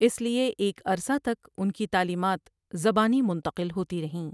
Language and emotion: Urdu, neutral